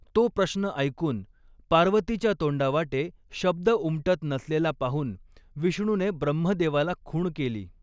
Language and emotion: Marathi, neutral